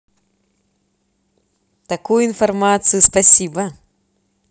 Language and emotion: Russian, positive